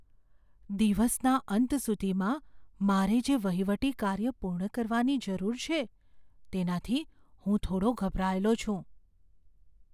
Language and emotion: Gujarati, fearful